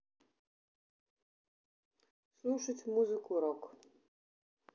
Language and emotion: Russian, neutral